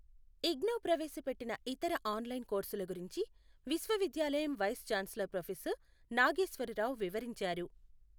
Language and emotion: Telugu, neutral